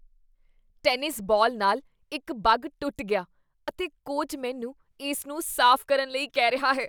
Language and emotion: Punjabi, disgusted